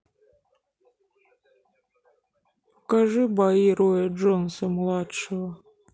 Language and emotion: Russian, sad